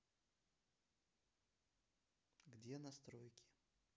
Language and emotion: Russian, neutral